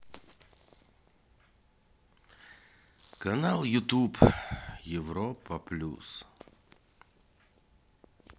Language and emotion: Russian, sad